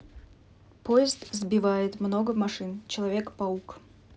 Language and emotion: Russian, neutral